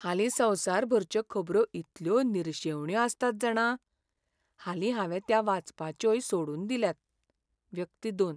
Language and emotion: Goan Konkani, sad